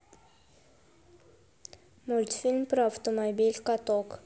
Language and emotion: Russian, neutral